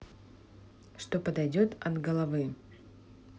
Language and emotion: Russian, neutral